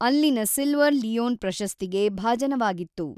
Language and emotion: Kannada, neutral